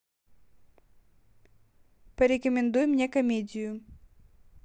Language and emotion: Russian, neutral